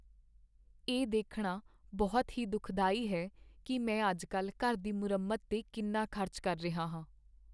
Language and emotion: Punjabi, sad